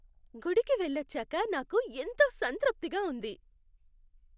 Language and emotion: Telugu, happy